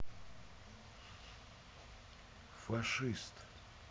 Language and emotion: Russian, neutral